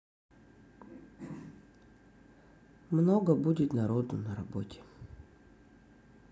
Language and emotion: Russian, sad